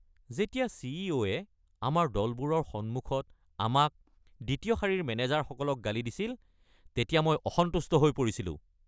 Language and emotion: Assamese, angry